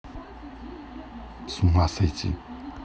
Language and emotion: Russian, neutral